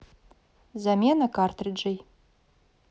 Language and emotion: Russian, neutral